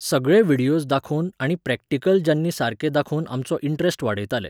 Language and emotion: Goan Konkani, neutral